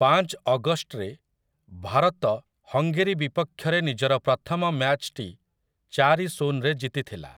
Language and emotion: Odia, neutral